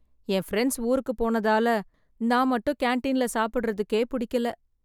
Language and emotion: Tamil, sad